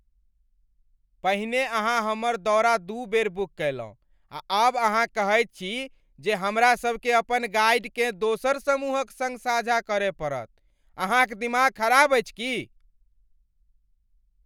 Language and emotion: Maithili, angry